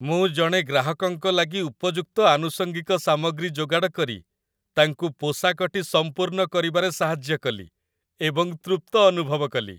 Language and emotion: Odia, happy